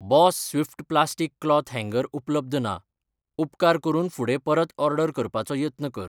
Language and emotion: Goan Konkani, neutral